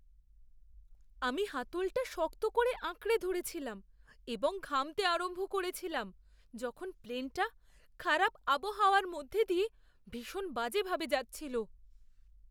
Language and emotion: Bengali, fearful